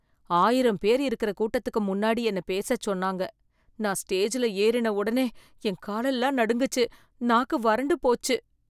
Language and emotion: Tamil, fearful